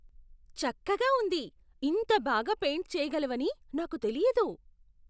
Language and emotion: Telugu, surprised